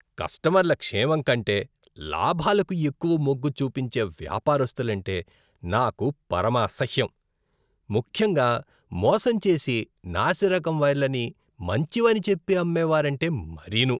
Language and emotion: Telugu, disgusted